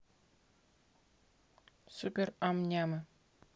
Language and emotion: Russian, neutral